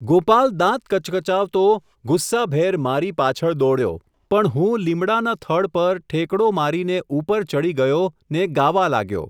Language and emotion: Gujarati, neutral